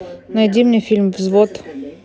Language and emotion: Russian, neutral